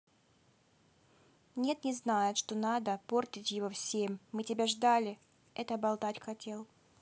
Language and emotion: Russian, neutral